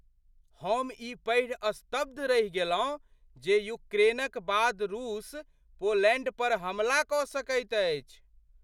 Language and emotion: Maithili, surprised